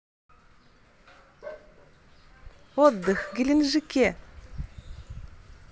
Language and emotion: Russian, positive